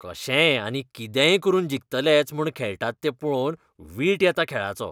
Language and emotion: Goan Konkani, disgusted